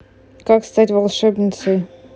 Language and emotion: Russian, neutral